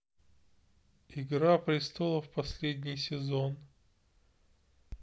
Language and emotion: Russian, neutral